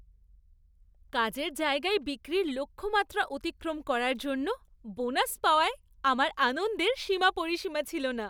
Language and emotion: Bengali, happy